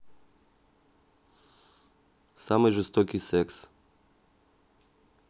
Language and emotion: Russian, neutral